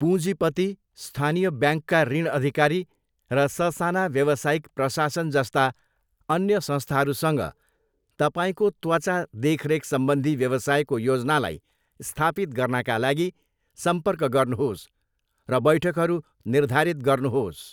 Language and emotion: Nepali, neutral